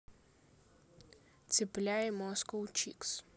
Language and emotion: Russian, neutral